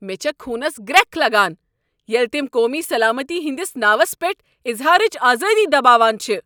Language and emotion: Kashmiri, angry